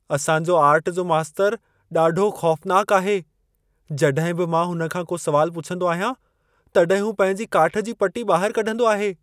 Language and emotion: Sindhi, fearful